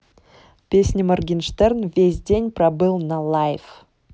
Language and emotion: Russian, neutral